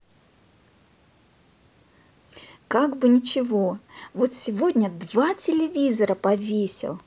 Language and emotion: Russian, positive